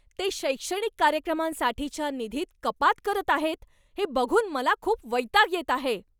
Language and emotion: Marathi, angry